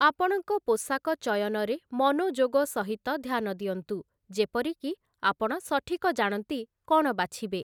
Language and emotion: Odia, neutral